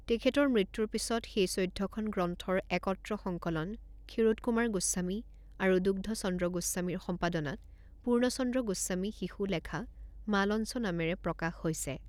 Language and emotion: Assamese, neutral